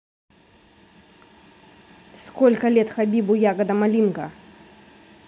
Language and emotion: Russian, angry